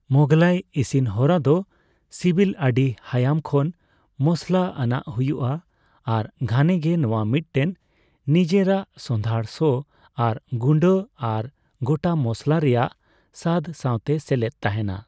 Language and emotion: Santali, neutral